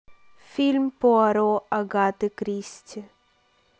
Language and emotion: Russian, neutral